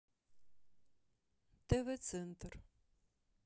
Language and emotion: Russian, neutral